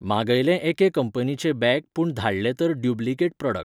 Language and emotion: Goan Konkani, neutral